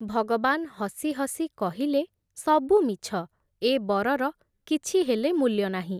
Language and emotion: Odia, neutral